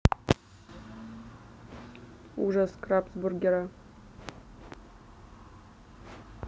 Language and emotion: Russian, neutral